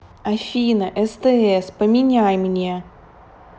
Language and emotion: Russian, angry